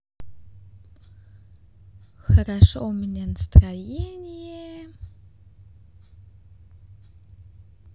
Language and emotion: Russian, positive